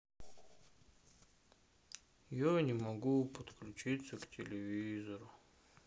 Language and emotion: Russian, sad